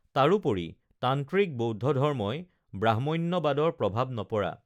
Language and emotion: Assamese, neutral